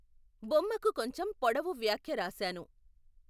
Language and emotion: Telugu, neutral